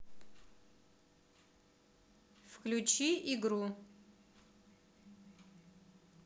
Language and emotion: Russian, neutral